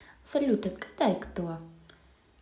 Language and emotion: Russian, positive